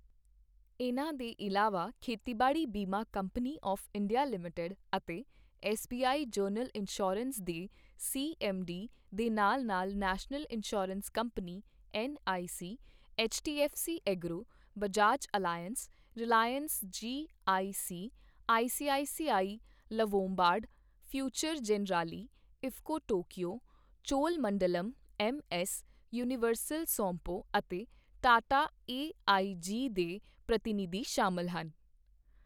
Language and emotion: Punjabi, neutral